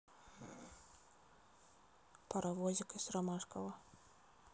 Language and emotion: Russian, neutral